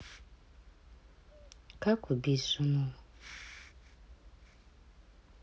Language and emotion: Russian, sad